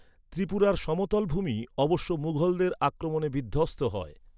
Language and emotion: Bengali, neutral